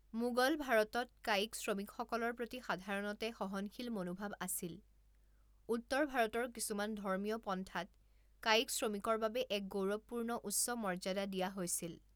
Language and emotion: Assamese, neutral